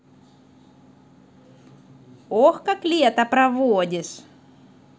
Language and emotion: Russian, positive